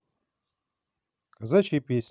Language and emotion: Russian, positive